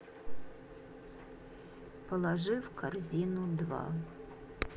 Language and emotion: Russian, neutral